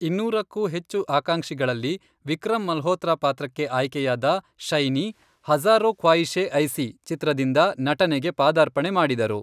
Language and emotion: Kannada, neutral